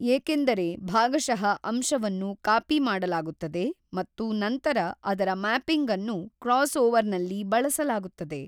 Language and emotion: Kannada, neutral